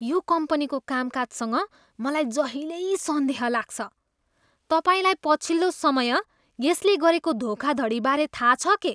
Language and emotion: Nepali, disgusted